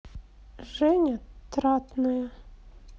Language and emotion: Russian, sad